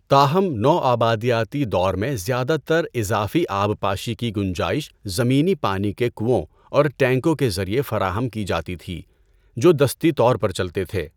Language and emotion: Urdu, neutral